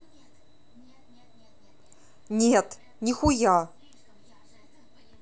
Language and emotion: Russian, angry